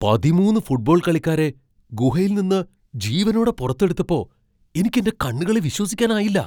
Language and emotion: Malayalam, surprised